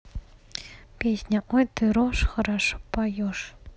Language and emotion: Russian, neutral